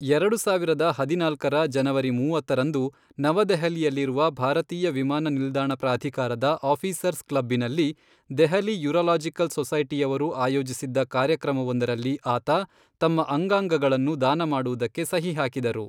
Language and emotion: Kannada, neutral